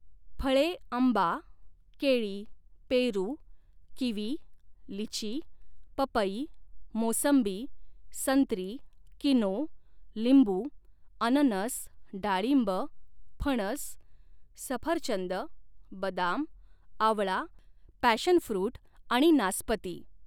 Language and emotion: Marathi, neutral